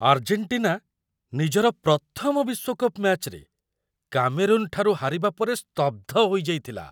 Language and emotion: Odia, surprised